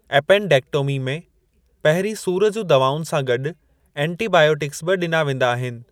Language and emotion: Sindhi, neutral